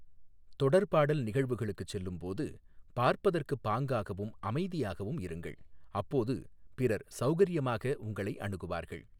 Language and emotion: Tamil, neutral